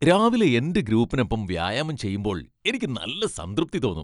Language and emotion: Malayalam, happy